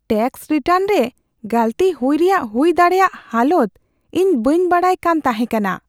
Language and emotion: Santali, fearful